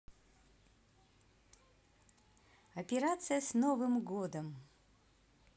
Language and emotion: Russian, positive